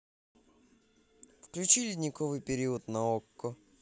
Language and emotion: Russian, positive